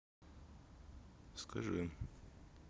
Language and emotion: Russian, neutral